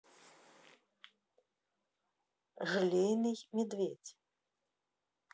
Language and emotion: Russian, neutral